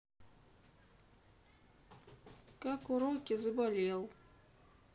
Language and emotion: Russian, sad